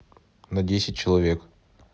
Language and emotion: Russian, neutral